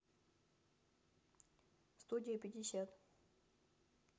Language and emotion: Russian, neutral